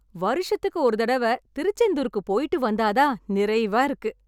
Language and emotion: Tamil, happy